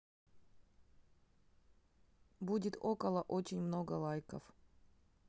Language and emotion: Russian, neutral